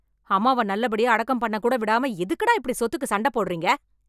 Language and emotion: Tamil, angry